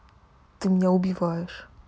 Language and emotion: Russian, sad